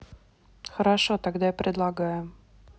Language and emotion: Russian, neutral